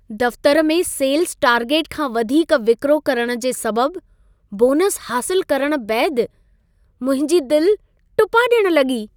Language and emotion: Sindhi, happy